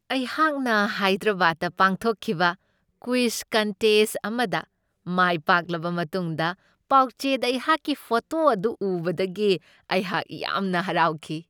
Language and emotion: Manipuri, happy